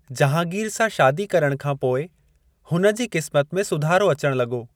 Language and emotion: Sindhi, neutral